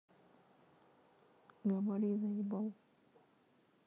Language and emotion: Russian, neutral